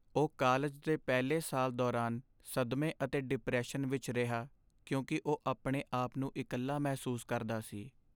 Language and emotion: Punjabi, sad